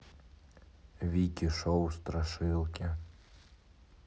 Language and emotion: Russian, neutral